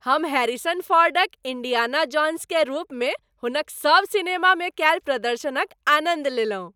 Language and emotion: Maithili, happy